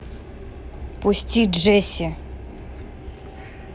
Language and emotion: Russian, neutral